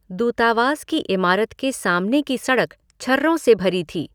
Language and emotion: Hindi, neutral